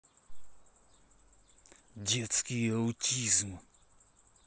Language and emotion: Russian, angry